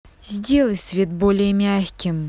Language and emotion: Russian, angry